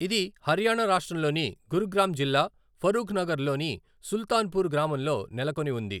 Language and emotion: Telugu, neutral